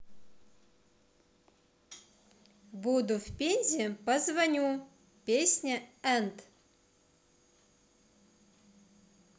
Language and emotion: Russian, positive